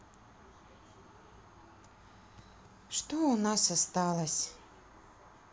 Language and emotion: Russian, sad